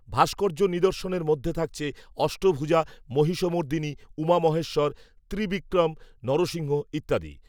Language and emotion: Bengali, neutral